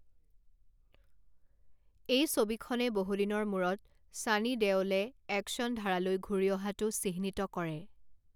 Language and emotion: Assamese, neutral